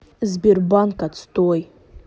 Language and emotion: Russian, neutral